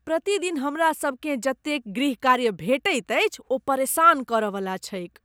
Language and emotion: Maithili, disgusted